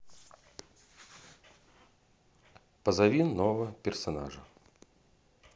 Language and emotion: Russian, neutral